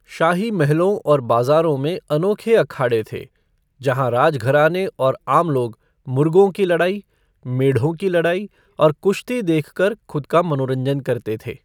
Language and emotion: Hindi, neutral